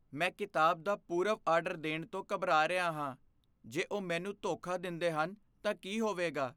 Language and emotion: Punjabi, fearful